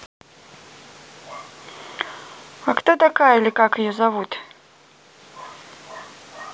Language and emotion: Russian, neutral